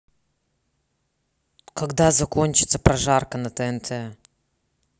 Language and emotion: Russian, neutral